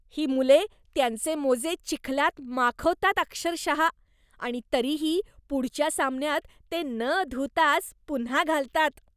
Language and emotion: Marathi, disgusted